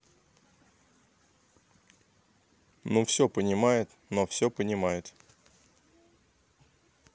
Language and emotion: Russian, neutral